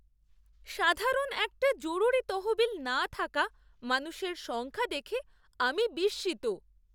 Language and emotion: Bengali, surprised